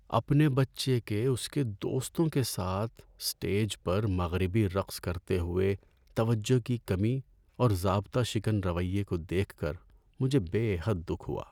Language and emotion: Urdu, sad